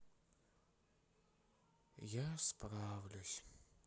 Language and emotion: Russian, sad